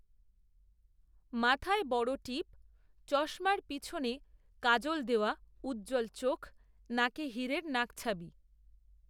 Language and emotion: Bengali, neutral